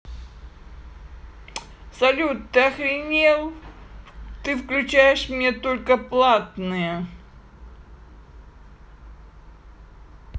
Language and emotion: Russian, angry